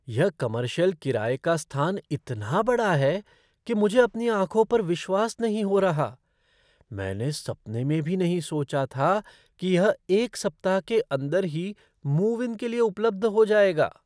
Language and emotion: Hindi, surprised